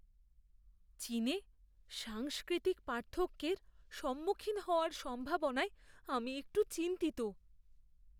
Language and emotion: Bengali, fearful